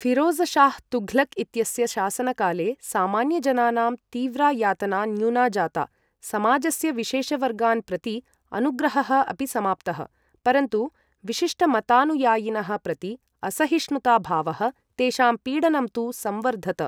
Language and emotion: Sanskrit, neutral